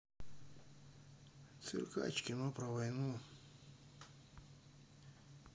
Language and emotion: Russian, neutral